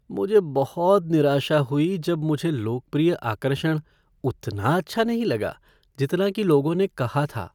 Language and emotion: Hindi, sad